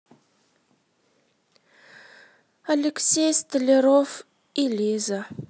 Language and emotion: Russian, sad